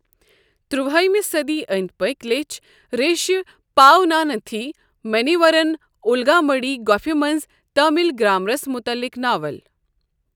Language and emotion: Kashmiri, neutral